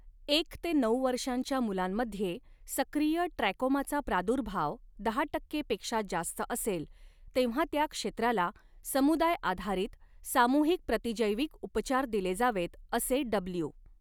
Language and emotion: Marathi, neutral